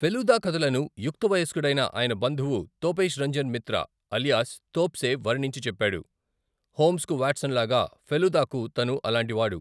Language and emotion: Telugu, neutral